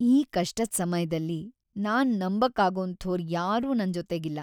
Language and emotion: Kannada, sad